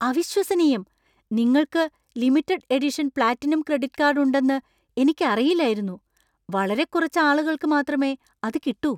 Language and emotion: Malayalam, surprised